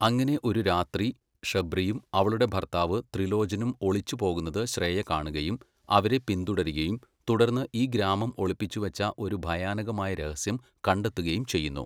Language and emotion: Malayalam, neutral